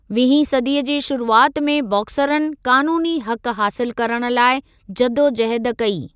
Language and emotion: Sindhi, neutral